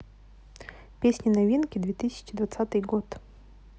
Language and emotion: Russian, neutral